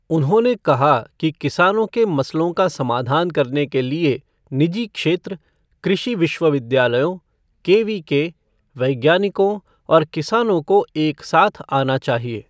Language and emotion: Hindi, neutral